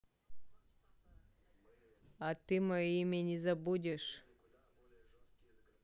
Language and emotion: Russian, neutral